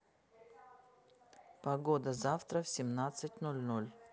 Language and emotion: Russian, neutral